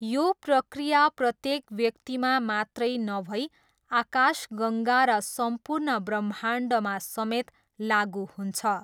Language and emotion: Nepali, neutral